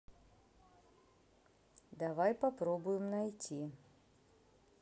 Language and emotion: Russian, neutral